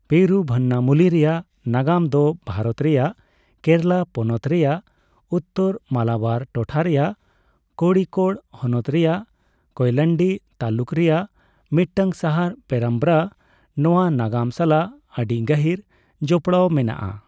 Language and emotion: Santali, neutral